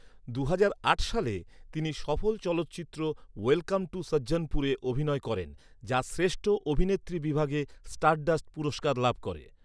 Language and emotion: Bengali, neutral